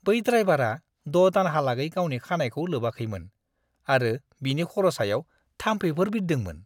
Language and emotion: Bodo, disgusted